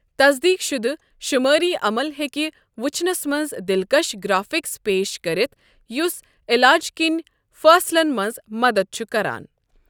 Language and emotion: Kashmiri, neutral